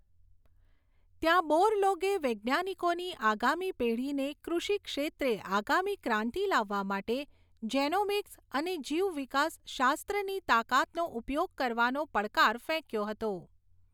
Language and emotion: Gujarati, neutral